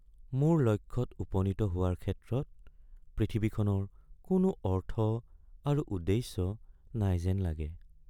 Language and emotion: Assamese, sad